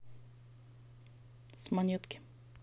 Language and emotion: Russian, neutral